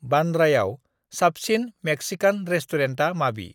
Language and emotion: Bodo, neutral